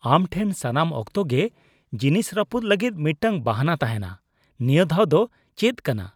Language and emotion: Santali, disgusted